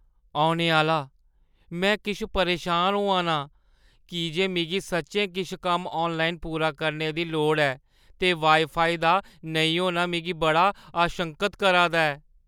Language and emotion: Dogri, fearful